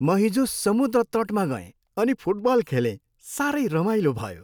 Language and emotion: Nepali, happy